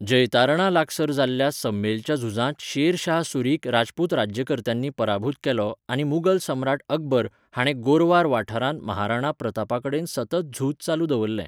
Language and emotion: Goan Konkani, neutral